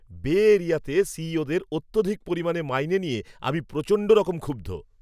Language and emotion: Bengali, angry